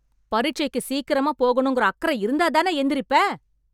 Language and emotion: Tamil, angry